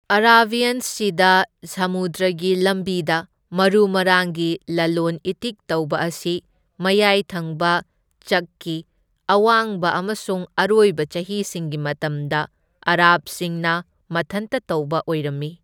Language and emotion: Manipuri, neutral